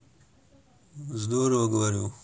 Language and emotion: Russian, neutral